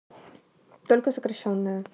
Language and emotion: Russian, neutral